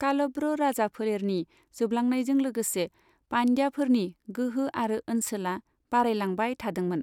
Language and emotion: Bodo, neutral